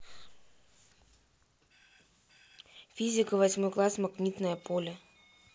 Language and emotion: Russian, neutral